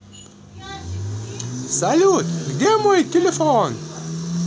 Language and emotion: Russian, positive